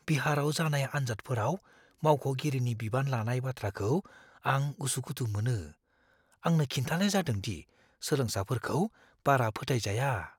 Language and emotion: Bodo, fearful